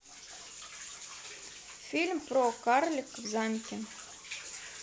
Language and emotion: Russian, neutral